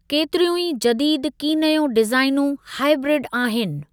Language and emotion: Sindhi, neutral